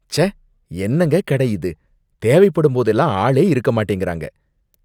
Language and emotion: Tamil, disgusted